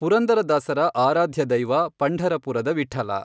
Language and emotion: Kannada, neutral